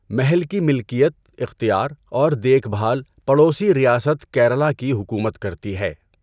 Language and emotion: Urdu, neutral